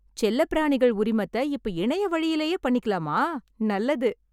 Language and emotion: Tamil, happy